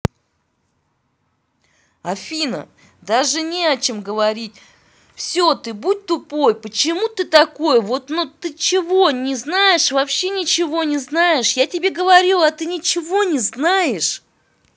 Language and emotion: Russian, angry